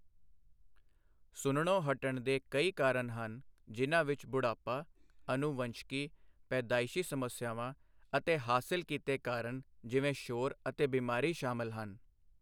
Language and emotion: Punjabi, neutral